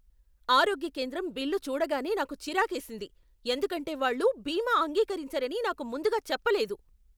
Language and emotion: Telugu, angry